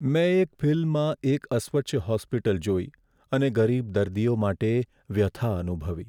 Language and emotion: Gujarati, sad